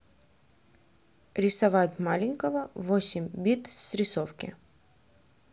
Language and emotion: Russian, neutral